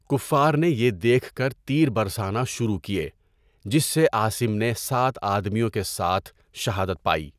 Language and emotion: Urdu, neutral